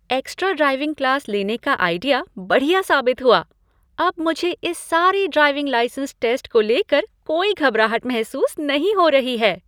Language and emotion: Hindi, happy